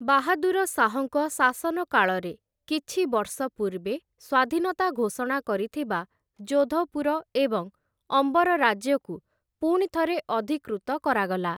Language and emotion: Odia, neutral